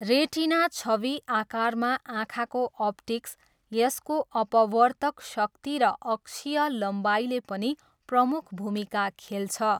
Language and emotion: Nepali, neutral